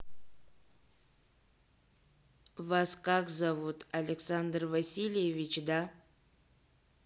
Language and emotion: Russian, neutral